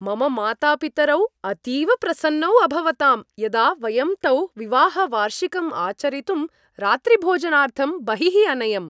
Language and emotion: Sanskrit, happy